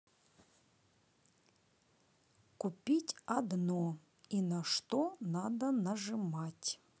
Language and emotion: Russian, neutral